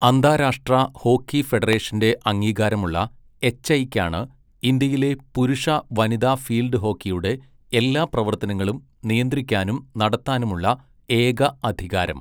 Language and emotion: Malayalam, neutral